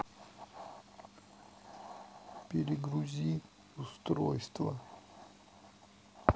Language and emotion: Russian, sad